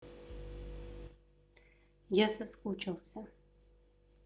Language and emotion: Russian, neutral